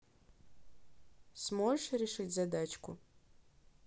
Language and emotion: Russian, neutral